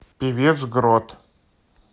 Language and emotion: Russian, neutral